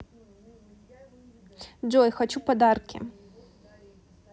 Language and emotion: Russian, neutral